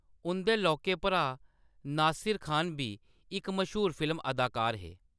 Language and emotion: Dogri, neutral